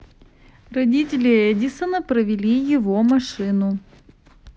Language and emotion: Russian, neutral